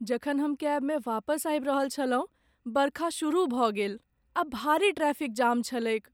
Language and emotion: Maithili, sad